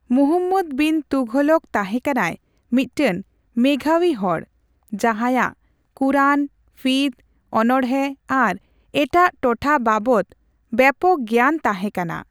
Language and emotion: Santali, neutral